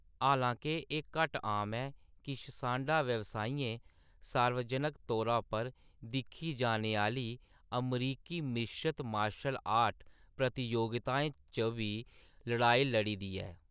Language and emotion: Dogri, neutral